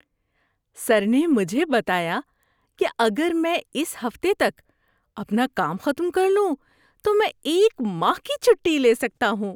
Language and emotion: Urdu, happy